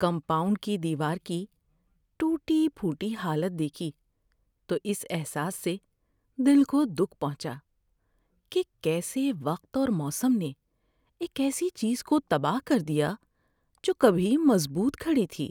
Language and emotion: Urdu, sad